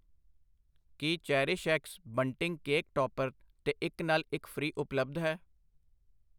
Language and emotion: Punjabi, neutral